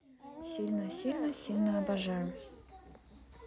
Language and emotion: Russian, neutral